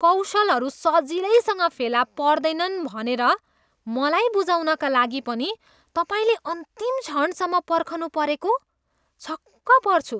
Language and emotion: Nepali, disgusted